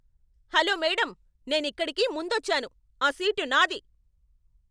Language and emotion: Telugu, angry